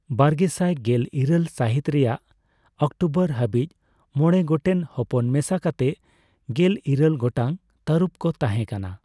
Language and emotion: Santali, neutral